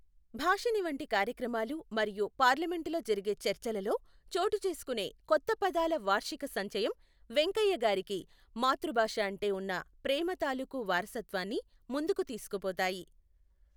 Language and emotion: Telugu, neutral